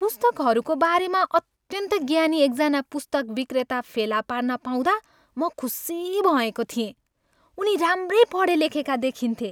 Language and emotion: Nepali, happy